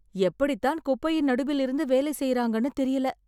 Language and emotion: Tamil, surprised